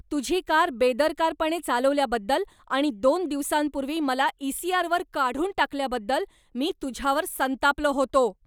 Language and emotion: Marathi, angry